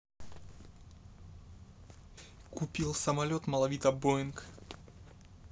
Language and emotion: Russian, neutral